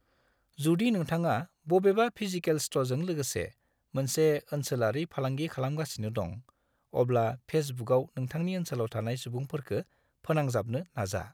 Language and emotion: Bodo, neutral